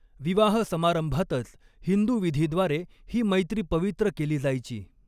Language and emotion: Marathi, neutral